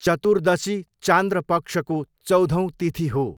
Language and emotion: Nepali, neutral